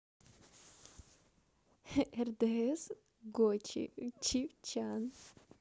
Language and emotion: Russian, positive